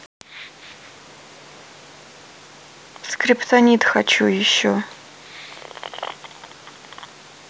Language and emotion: Russian, sad